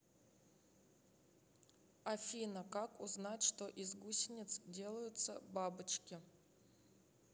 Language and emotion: Russian, neutral